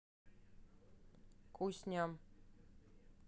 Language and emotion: Russian, neutral